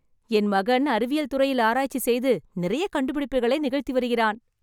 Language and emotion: Tamil, happy